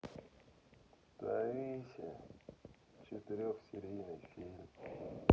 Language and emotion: Russian, sad